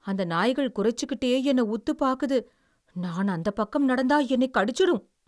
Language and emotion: Tamil, fearful